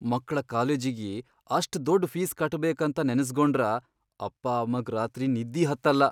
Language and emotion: Kannada, fearful